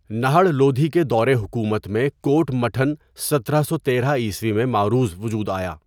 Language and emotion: Urdu, neutral